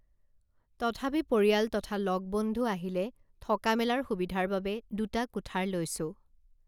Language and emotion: Assamese, neutral